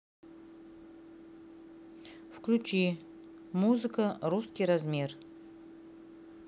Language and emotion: Russian, neutral